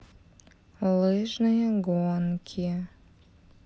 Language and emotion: Russian, neutral